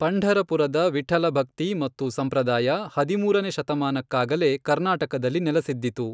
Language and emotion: Kannada, neutral